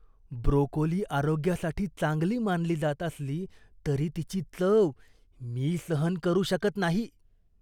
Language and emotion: Marathi, disgusted